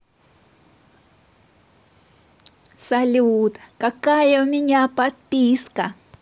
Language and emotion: Russian, positive